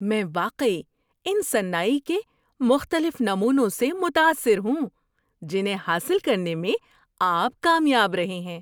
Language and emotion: Urdu, happy